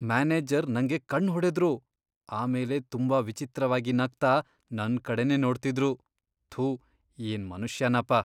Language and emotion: Kannada, disgusted